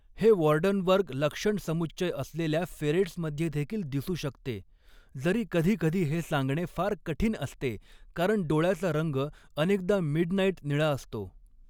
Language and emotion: Marathi, neutral